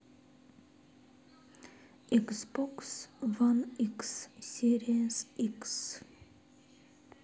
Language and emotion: Russian, sad